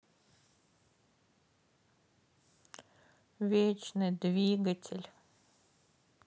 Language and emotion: Russian, sad